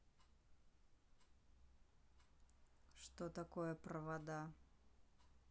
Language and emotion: Russian, neutral